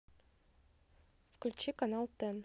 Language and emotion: Russian, neutral